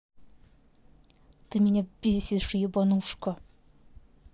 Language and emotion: Russian, angry